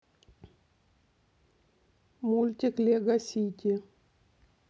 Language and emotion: Russian, neutral